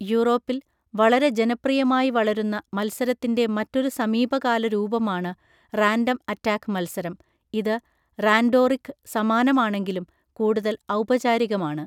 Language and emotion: Malayalam, neutral